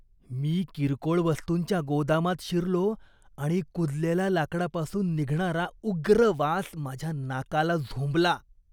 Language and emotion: Marathi, disgusted